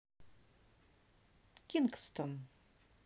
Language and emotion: Russian, neutral